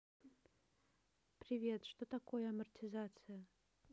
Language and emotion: Russian, neutral